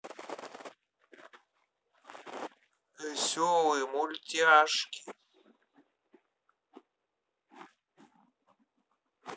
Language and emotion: Russian, neutral